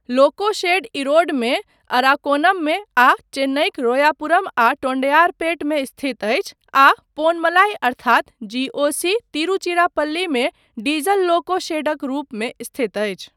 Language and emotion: Maithili, neutral